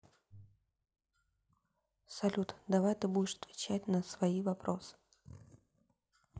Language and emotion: Russian, neutral